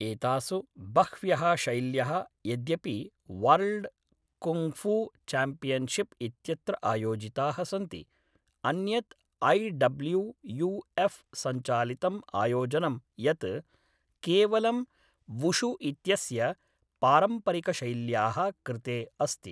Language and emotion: Sanskrit, neutral